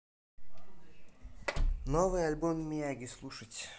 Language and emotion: Russian, neutral